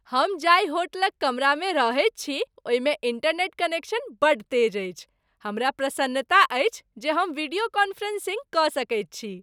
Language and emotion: Maithili, happy